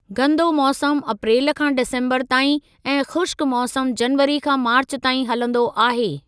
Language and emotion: Sindhi, neutral